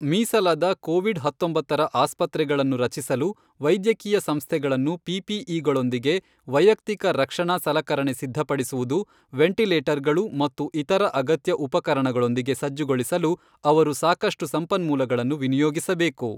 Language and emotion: Kannada, neutral